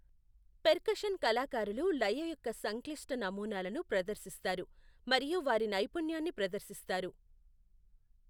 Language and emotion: Telugu, neutral